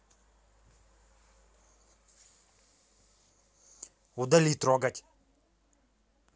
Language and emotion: Russian, angry